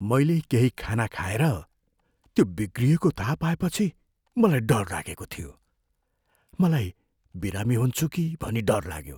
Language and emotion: Nepali, fearful